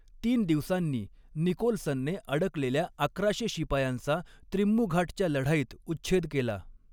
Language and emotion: Marathi, neutral